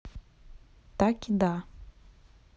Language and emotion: Russian, neutral